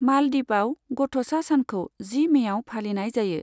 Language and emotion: Bodo, neutral